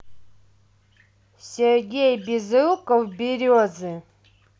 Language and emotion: Russian, neutral